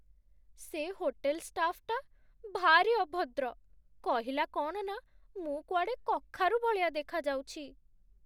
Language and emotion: Odia, sad